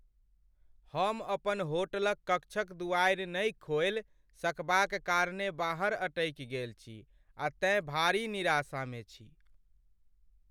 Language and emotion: Maithili, sad